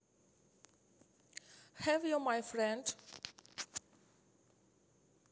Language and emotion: Russian, neutral